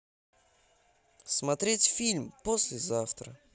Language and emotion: Russian, positive